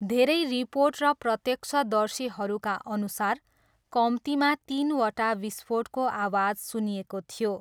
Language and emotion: Nepali, neutral